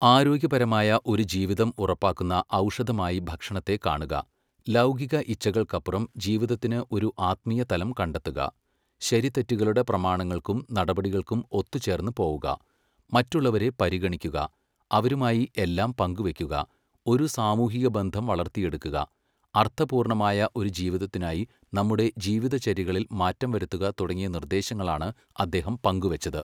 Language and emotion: Malayalam, neutral